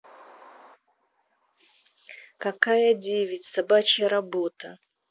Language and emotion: Russian, neutral